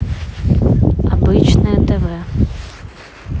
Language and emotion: Russian, neutral